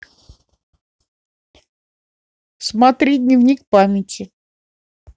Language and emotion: Russian, neutral